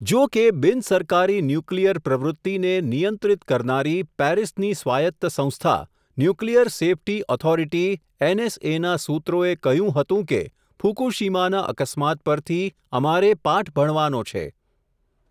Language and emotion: Gujarati, neutral